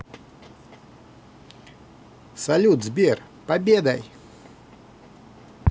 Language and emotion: Russian, positive